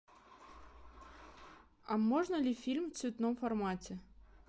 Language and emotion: Russian, neutral